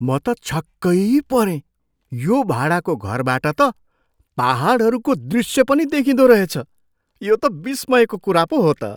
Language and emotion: Nepali, surprised